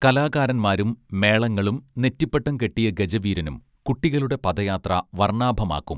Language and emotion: Malayalam, neutral